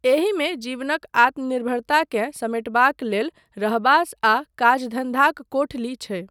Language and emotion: Maithili, neutral